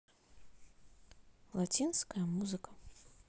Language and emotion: Russian, neutral